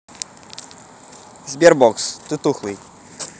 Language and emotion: Russian, positive